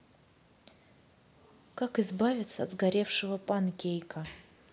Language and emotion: Russian, neutral